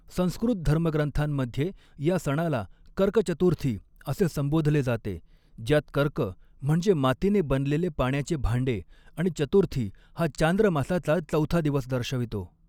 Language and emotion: Marathi, neutral